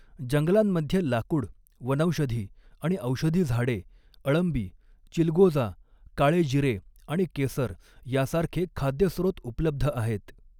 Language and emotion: Marathi, neutral